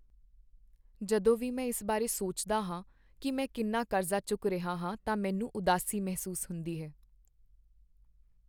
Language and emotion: Punjabi, sad